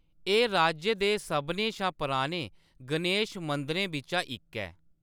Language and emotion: Dogri, neutral